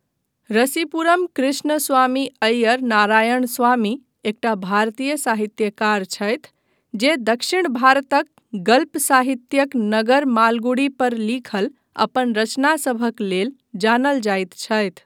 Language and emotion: Maithili, neutral